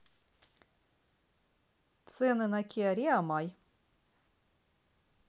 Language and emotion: Russian, neutral